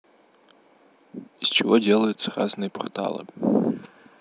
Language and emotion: Russian, neutral